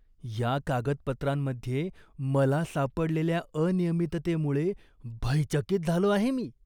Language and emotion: Marathi, disgusted